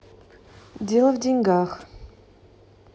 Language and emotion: Russian, neutral